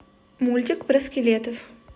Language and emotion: Russian, neutral